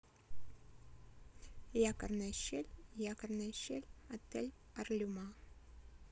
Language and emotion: Russian, neutral